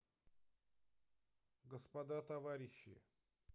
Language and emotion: Russian, neutral